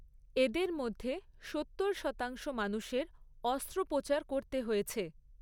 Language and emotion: Bengali, neutral